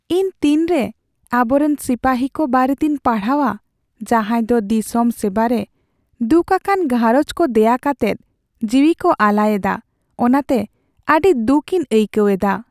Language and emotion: Santali, sad